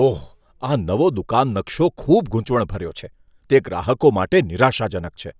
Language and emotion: Gujarati, disgusted